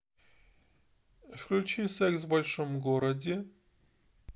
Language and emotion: Russian, neutral